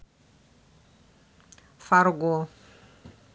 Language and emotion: Russian, neutral